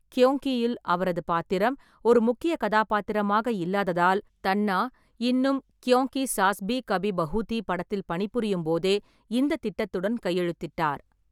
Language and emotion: Tamil, neutral